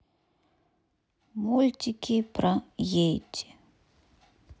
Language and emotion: Russian, neutral